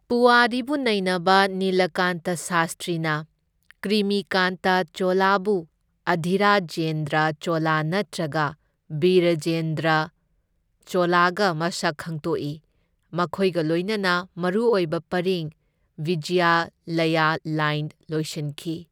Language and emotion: Manipuri, neutral